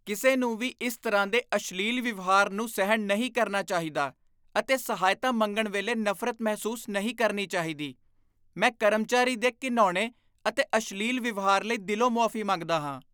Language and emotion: Punjabi, disgusted